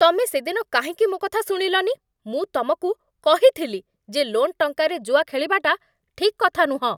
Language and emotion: Odia, angry